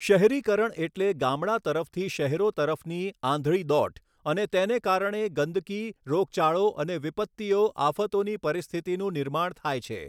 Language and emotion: Gujarati, neutral